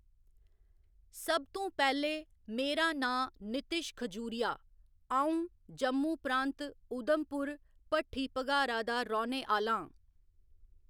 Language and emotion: Dogri, neutral